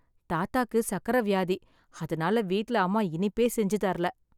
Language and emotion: Tamil, sad